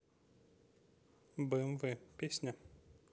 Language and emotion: Russian, neutral